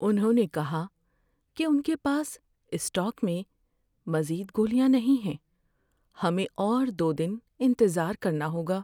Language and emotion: Urdu, sad